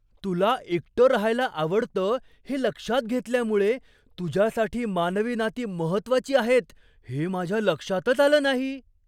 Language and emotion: Marathi, surprised